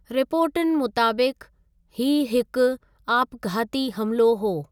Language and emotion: Sindhi, neutral